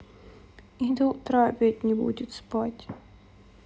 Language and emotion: Russian, sad